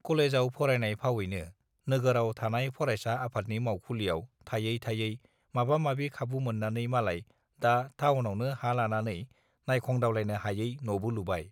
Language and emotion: Bodo, neutral